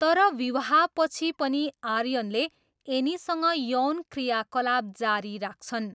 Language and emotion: Nepali, neutral